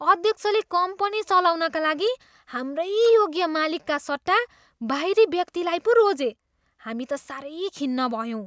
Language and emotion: Nepali, disgusted